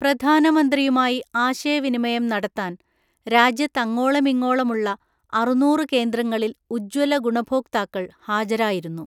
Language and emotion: Malayalam, neutral